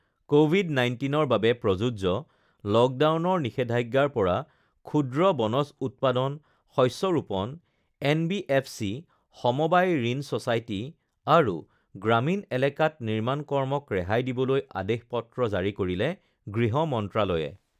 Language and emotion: Assamese, neutral